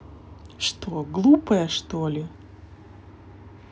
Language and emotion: Russian, neutral